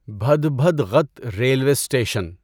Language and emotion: Urdu, neutral